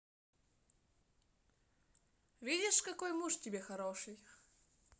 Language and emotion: Russian, positive